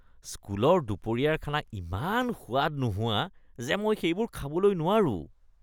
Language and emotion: Assamese, disgusted